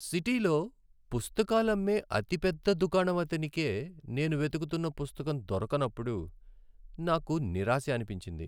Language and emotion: Telugu, sad